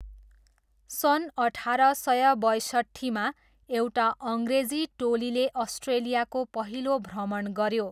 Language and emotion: Nepali, neutral